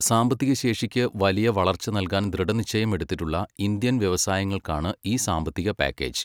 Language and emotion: Malayalam, neutral